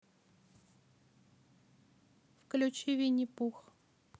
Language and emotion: Russian, neutral